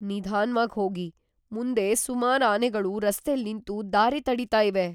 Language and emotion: Kannada, fearful